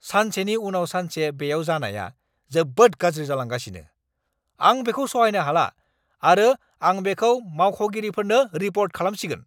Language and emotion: Bodo, angry